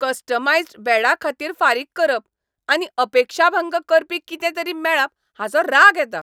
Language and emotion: Goan Konkani, angry